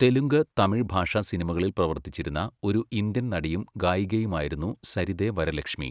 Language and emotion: Malayalam, neutral